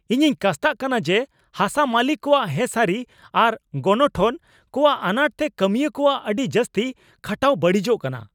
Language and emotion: Santali, angry